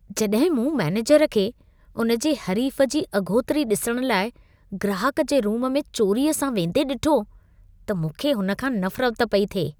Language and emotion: Sindhi, disgusted